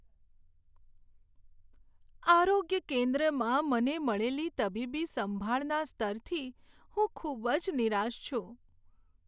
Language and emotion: Gujarati, sad